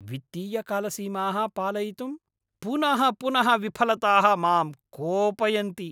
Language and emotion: Sanskrit, angry